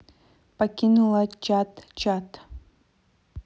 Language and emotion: Russian, neutral